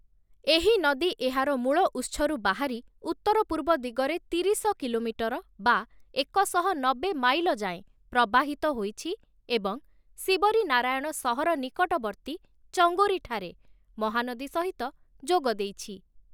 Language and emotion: Odia, neutral